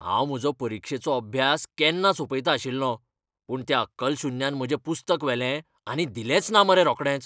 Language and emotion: Goan Konkani, angry